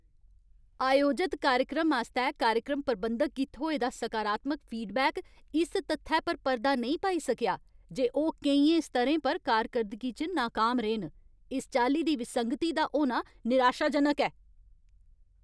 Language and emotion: Dogri, angry